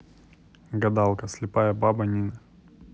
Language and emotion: Russian, neutral